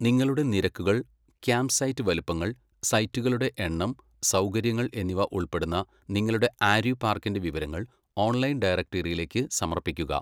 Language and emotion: Malayalam, neutral